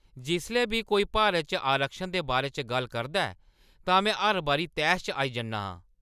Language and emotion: Dogri, angry